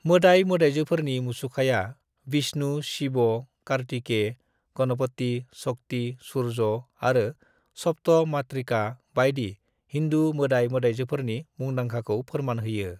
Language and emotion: Bodo, neutral